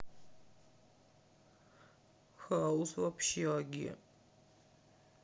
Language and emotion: Russian, sad